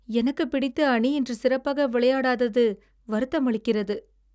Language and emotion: Tamil, sad